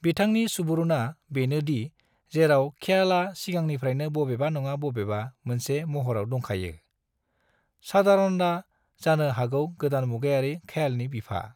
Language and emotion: Bodo, neutral